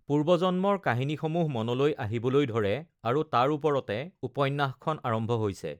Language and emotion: Assamese, neutral